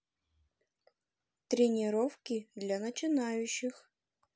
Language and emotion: Russian, positive